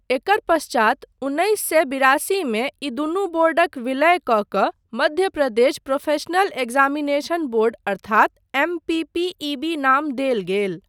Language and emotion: Maithili, neutral